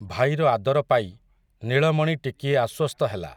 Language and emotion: Odia, neutral